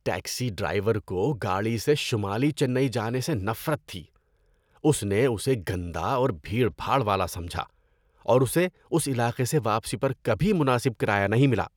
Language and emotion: Urdu, disgusted